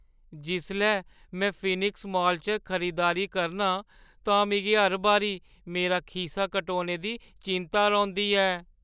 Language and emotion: Dogri, fearful